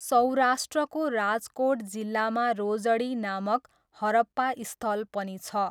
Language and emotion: Nepali, neutral